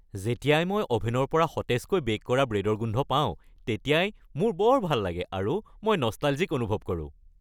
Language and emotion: Assamese, happy